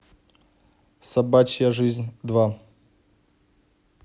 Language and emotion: Russian, neutral